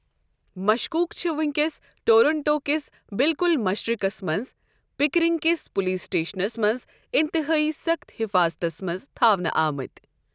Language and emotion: Kashmiri, neutral